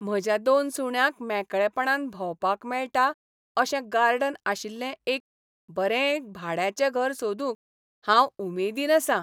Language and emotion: Goan Konkani, happy